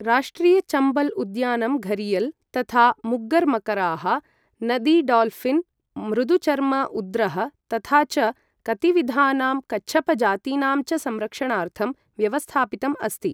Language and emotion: Sanskrit, neutral